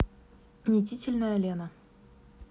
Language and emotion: Russian, neutral